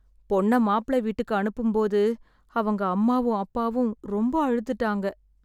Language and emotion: Tamil, sad